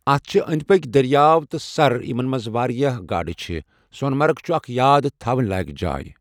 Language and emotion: Kashmiri, neutral